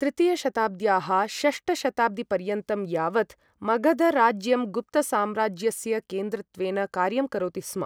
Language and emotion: Sanskrit, neutral